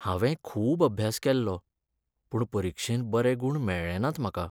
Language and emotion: Goan Konkani, sad